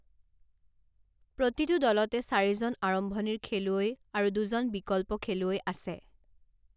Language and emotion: Assamese, neutral